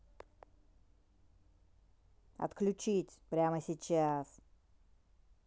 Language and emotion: Russian, angry